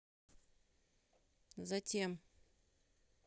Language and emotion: Russian, neutral